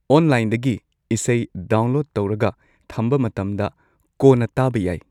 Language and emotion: Manipuri, neutral